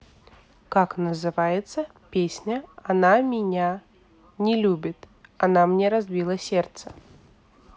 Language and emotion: Russian, neutral